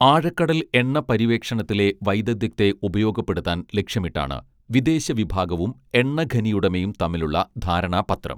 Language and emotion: Malayalam, neutral